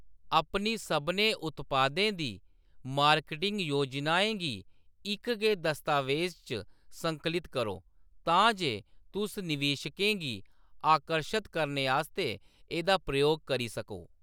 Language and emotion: Dogri, neutral